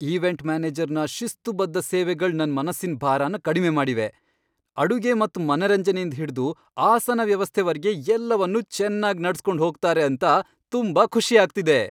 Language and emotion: Kannada, happy